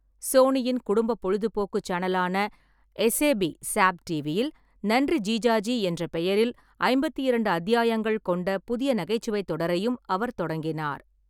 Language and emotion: Tamil, neutral